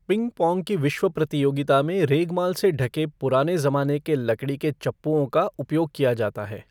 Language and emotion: Hindi, neutral